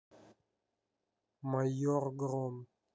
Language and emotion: Russian, neutral